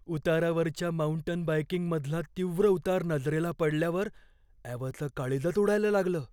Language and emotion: Marathi, fearful